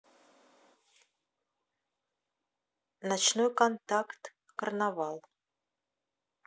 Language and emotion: Russian, neutral